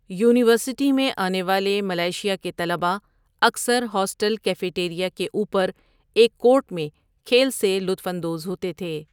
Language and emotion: Urdu, neutral